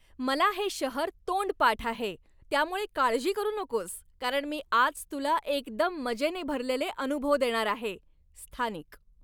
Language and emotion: Marathi, happy